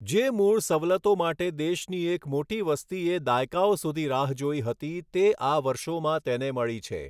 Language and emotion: Gujarati, neutral